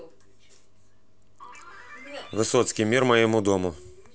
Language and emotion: Russian, neutral